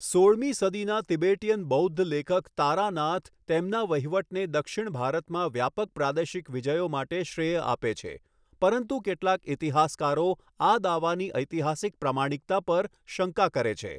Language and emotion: Gujarati, neutral